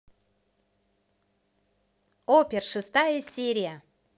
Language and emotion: Russian, positive